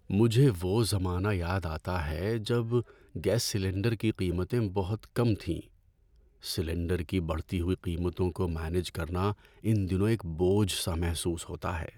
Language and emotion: Urdu, sad